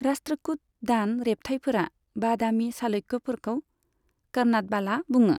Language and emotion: Bodo, neutral